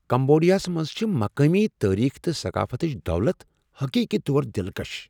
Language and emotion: Kashmiri, surprised